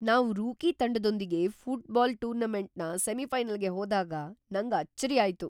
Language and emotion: Kannada, surprised